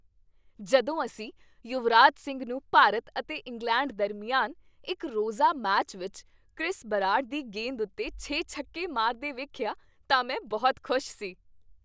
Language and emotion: Punjabi, happy